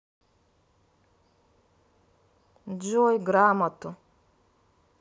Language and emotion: Russian, neutral